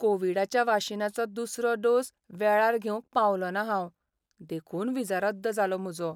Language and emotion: Goan Konkani, sad